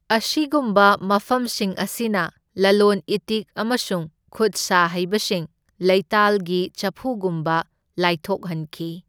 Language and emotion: Manipuri, neutral